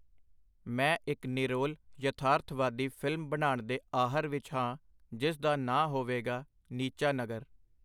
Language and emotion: Punjabi, neutral